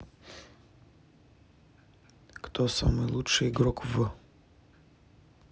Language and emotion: Russian, neutral